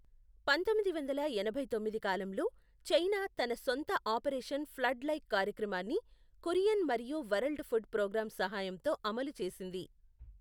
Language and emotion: Telugu, neutral